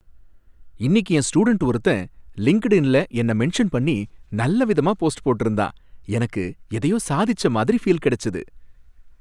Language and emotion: Tamil, happy